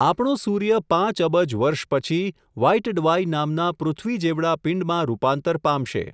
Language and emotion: Gujarati, neutral